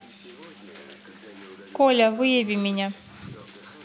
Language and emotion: Russian, neutral